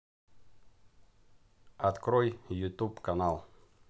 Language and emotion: Russian, neutral